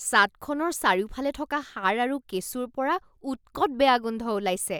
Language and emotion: Assamese, disgusted